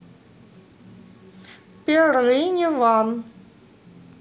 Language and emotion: Russian, neutral